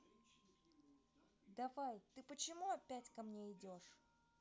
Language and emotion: Russian, angry